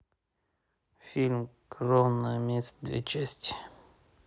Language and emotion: Russian, neutral